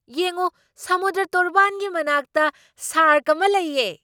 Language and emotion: Manipuri, surprised